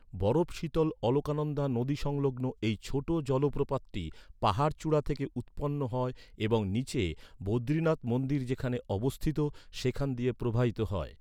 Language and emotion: Bengali, neutral